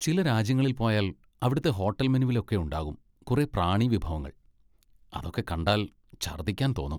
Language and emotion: Malayalam, disgusted